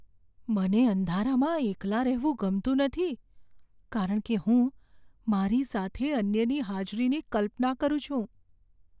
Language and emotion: Gujarati, fearful